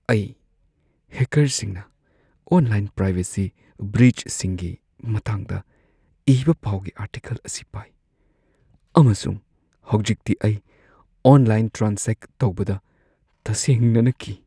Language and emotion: Manipuri, fearful